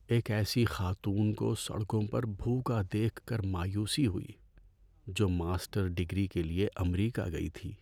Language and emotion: Urdu, sad